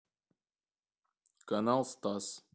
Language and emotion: Russian, neutral